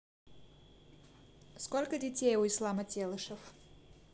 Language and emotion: Russian, neutral